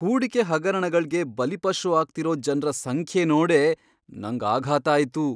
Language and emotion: Kannada, surprised